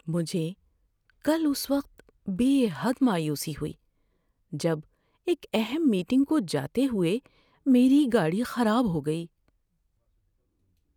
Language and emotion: Urdu, sad